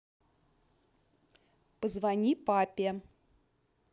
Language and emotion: Russian, neutral